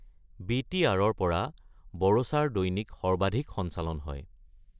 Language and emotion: Assamese, neutral